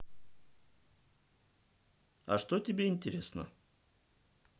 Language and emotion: Russian, neutral